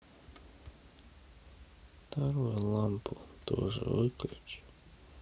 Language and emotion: Russian, sad